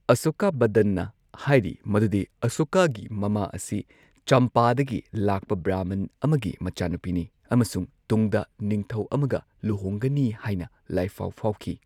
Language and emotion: Manipuri, neutral